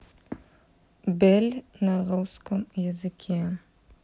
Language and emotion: Russian, neutral